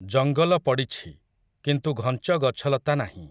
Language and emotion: Odia, neutral